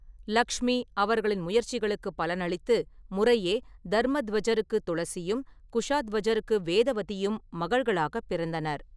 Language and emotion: Tamil, neutral